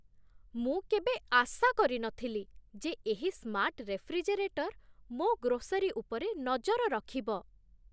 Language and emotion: Odia, surprised